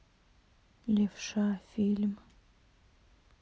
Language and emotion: Russian, sad